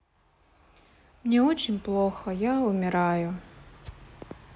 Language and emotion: Russian, sad